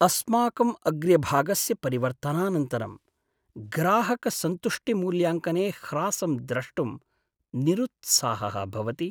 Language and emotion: Sanskrit, sad